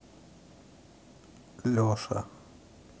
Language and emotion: Russian, neutral